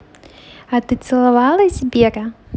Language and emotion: Russian, positive